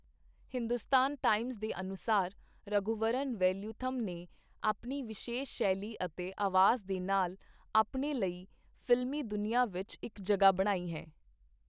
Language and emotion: Punjabi, neutral